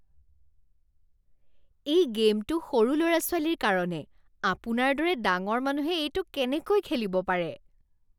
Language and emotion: Assamese, disgusted